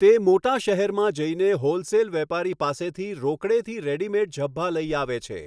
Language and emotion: Gujarati, neutral